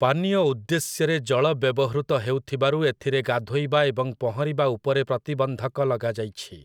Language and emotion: Odia, neutral